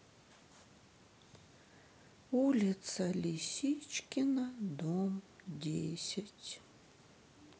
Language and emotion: Russian, sad